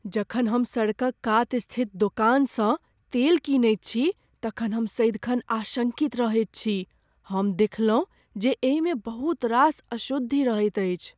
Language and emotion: Maithili, fearful